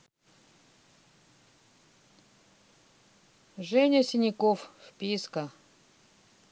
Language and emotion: Russian, neutral